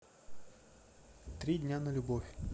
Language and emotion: Russian, neutral